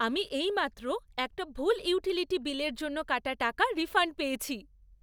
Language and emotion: Bengali, happy